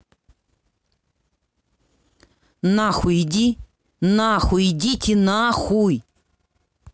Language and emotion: Russian, angry